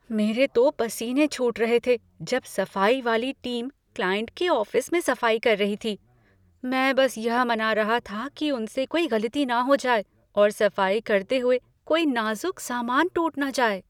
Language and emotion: Hindi, fearful